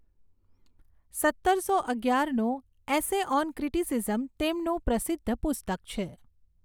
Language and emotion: Gujarati, neutral